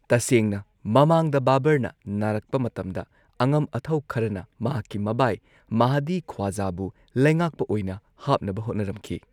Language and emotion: Manipuri, neutral